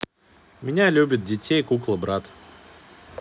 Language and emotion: Russian, neutral